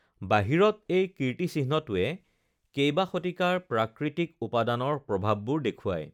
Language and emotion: Assamese, neutral